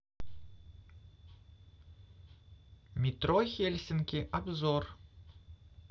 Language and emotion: Russian, neutral